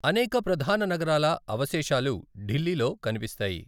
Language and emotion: Telugu, neutral